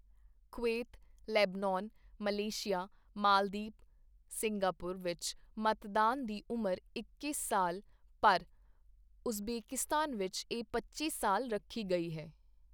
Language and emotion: Punjabi, neutral